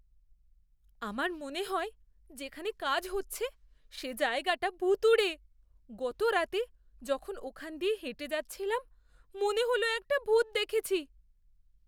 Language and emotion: Bengali, fearful